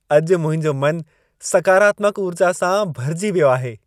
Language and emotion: Sindhi, happy